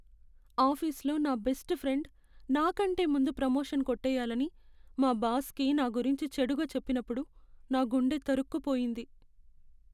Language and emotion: Telugu, sad